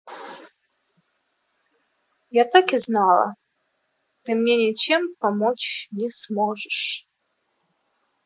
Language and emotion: Russian, sad